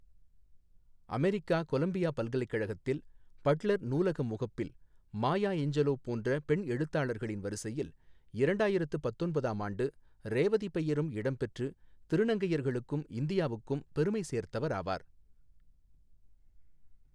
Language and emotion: Tamil, neutral